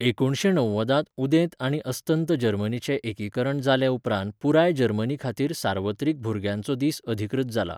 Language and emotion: Goan Konkani, neutral